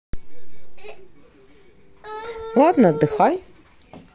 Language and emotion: Russian, neutral